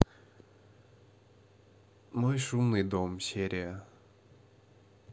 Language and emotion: Russian, neutral